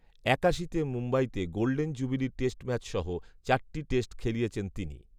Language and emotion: Bengali, neutral